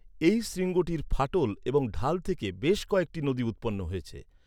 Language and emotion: Bengali, neutral